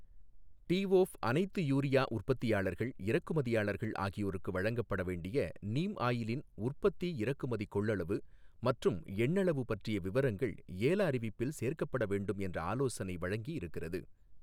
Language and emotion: Tamil, neutral